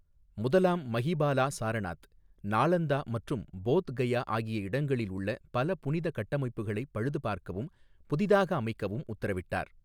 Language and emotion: Tamil, neutral